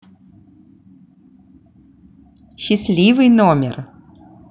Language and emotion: Russian, positive